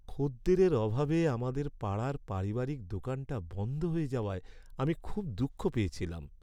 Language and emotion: Bengali, sad